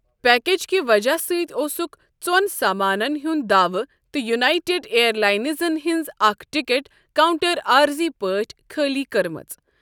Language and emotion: Kashmiri, neutral